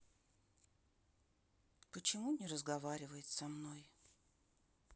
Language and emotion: Russian, sad